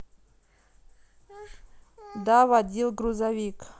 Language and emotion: Russian, neutral